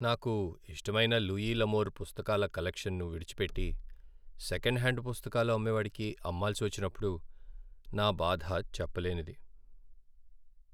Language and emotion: Telugu, sad